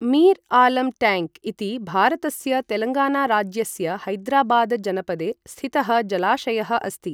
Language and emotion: Sanskrit, neutral